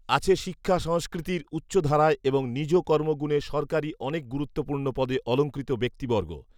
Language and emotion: Bengali, neutral